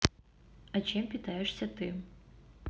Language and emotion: Russian, neutral